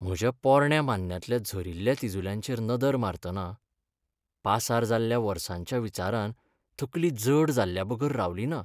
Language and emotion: Goan Konkani, sad